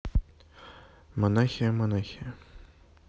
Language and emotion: Russian, neutral